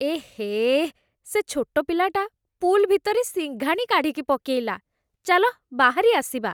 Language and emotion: Odia, disgusted